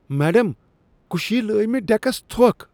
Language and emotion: Kashmiri, disgusted